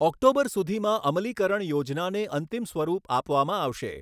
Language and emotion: Gujarati, neutral